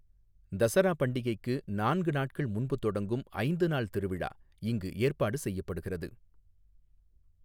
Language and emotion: Tamil, neutral